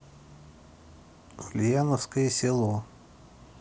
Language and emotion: Russian, neutral